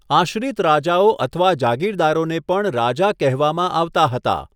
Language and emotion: Gujarati, neutral